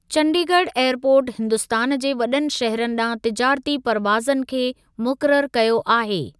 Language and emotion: Sindhi, neutral